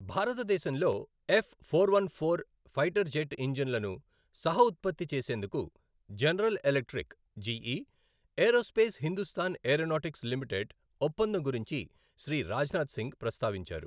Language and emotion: Telugu, neutral